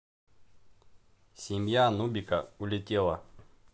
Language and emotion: Russian, neutral